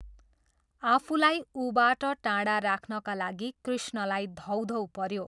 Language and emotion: Nepali, neutral